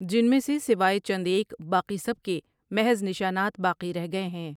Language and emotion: Urdu, neutral